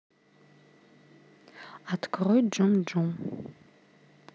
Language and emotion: Russian, neutral